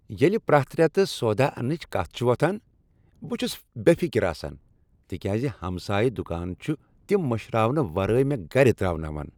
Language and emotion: Kashmiri, happy